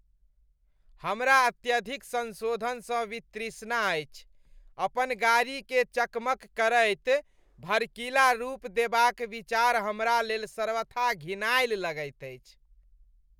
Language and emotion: Maithili, disgusted